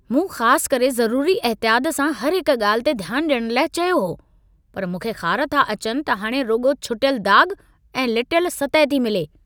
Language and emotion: Sindhi, angry